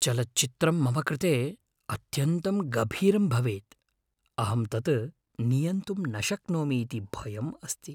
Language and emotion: Sanskrit, fearful